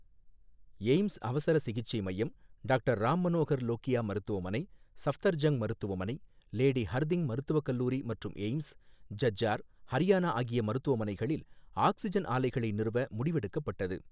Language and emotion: Tamil, neutral